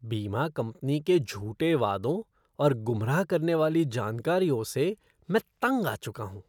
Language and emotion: Hindi, disgusted